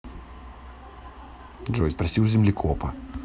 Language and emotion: Russian, neutral